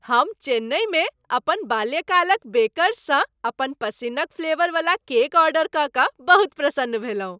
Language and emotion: Maithili, happy